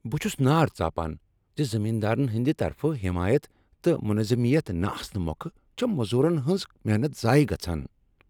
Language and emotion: Kashmiri, angry